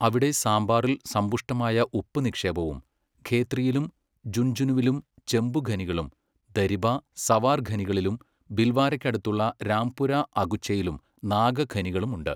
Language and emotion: Malayalam, neutral